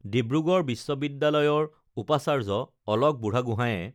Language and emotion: Assamese, neutral